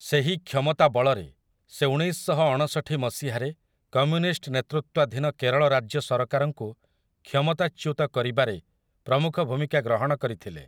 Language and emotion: Odia, neutral